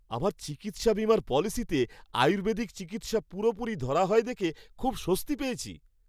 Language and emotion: Bengali, happy